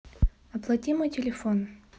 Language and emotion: Russian, neutral